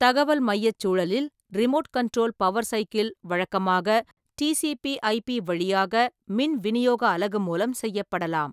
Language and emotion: Tamil, neutral